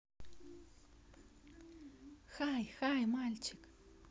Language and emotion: Russian, positive